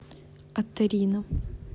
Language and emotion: Russian, neutral